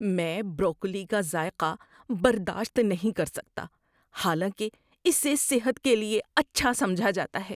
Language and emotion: Urdu, disgusted